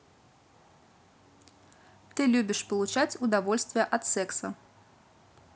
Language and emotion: Russian, neutral